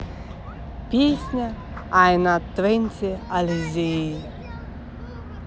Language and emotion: Russian, neutral